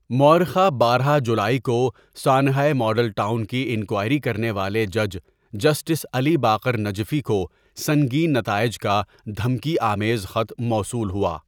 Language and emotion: Urdu, neutral